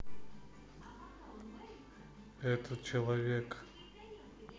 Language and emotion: Russian, neutral